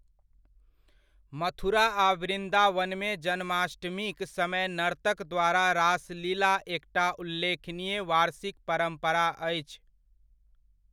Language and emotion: Maithili, neutral